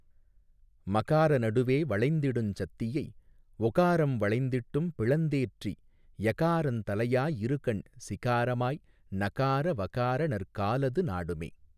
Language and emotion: Tamil, neutral